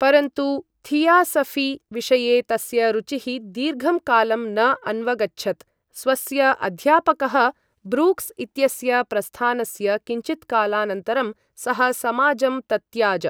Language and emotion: Sanskrit, neutral